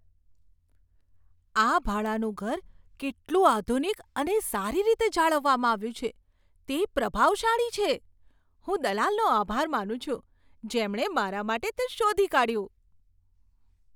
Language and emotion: Gujarati, surprised